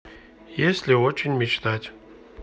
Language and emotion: Russian, neutral